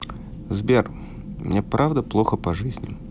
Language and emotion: Russian, sad